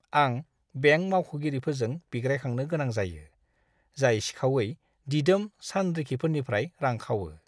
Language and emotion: Bodo, disgusted